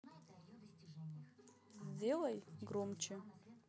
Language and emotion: Russian, neutral